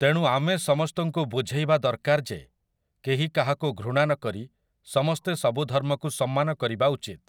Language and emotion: Odia, neutral